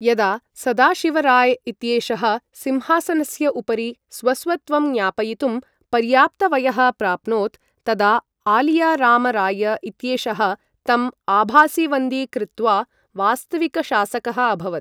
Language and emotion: Sanskrit, neutral